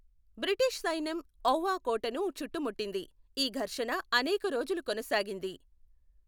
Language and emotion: Telugu, neutral